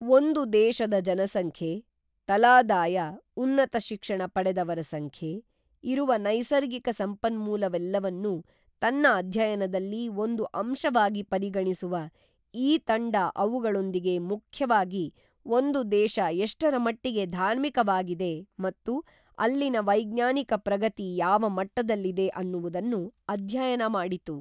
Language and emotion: Kannada, neutral